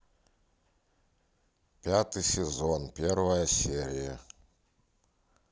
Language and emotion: Russian, neutral